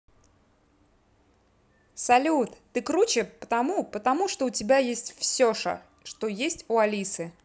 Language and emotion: Russian, positive